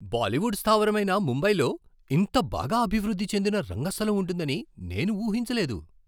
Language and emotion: Telugu, surprised